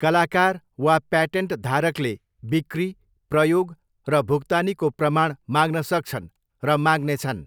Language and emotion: Nepali, neutral